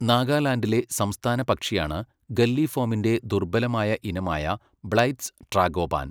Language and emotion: Malayalam, neutral